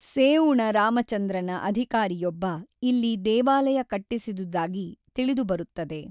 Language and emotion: Kannada, neutral